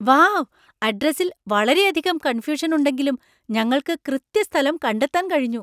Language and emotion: Malayalam, surprised